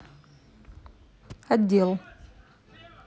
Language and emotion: Russian, neutral